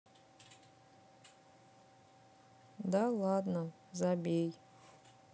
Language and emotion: Russian, sad